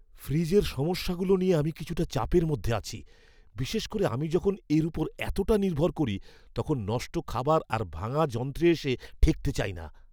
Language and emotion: Bengali, fearful